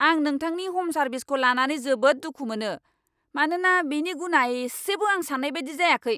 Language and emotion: Bodo, angry